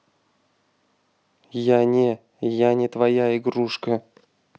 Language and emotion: Russian, neutral